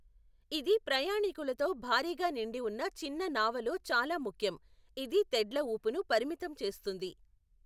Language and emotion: Telugu, neutral